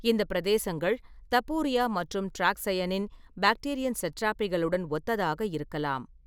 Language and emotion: Tamil, neutral